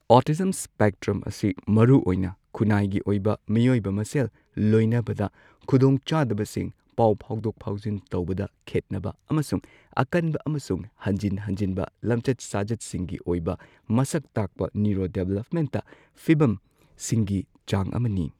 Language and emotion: Manipuri, neutral